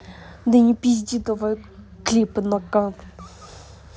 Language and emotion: Russian, angry